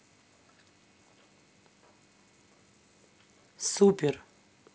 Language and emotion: Russian, neutral